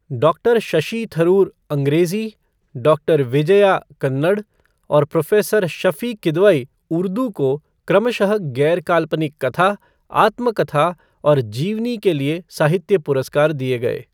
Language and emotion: Hindi, neutral